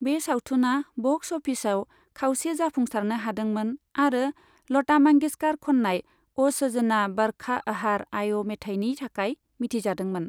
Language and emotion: Bodo, neutral